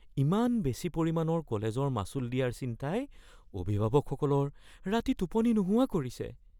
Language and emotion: Assamese, fearful